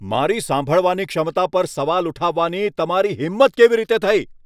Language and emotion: Gujarati, angry